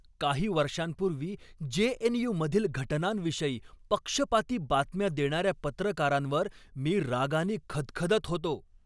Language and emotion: Marathi, angry